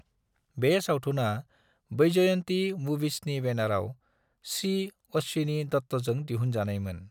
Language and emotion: Bodo, neutral